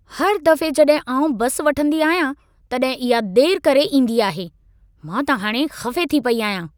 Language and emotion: Sindhi, angry